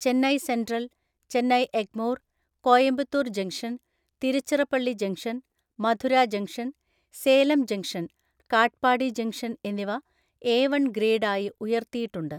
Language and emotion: Malayalam, neutral